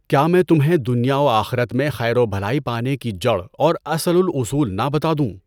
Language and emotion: Urdu, neutral